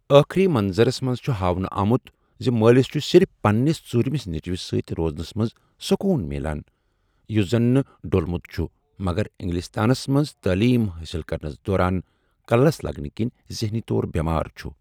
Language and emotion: Kashmiri, neutral